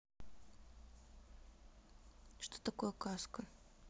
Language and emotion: Russian, neutral